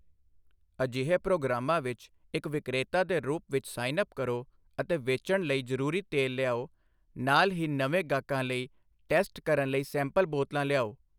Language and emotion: Punjabi, neutral